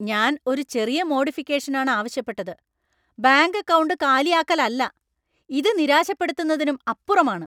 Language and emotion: Malayalam, angry